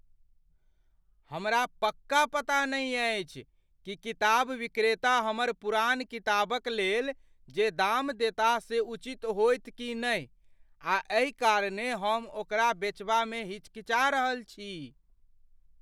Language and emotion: Maithili, fearful